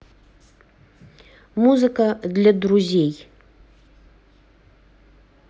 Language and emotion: Russian, neutral